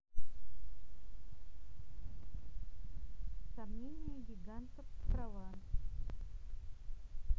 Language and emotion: Russian, neutral